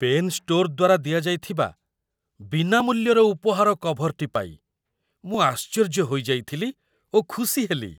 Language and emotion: Odia, surprised